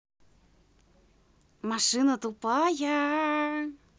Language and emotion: Russian, positive